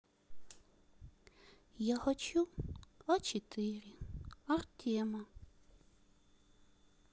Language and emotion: Russian, sad